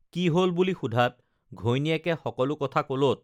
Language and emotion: Assamese, neutral